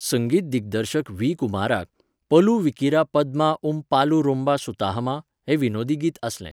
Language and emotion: Goan Konkani, neutral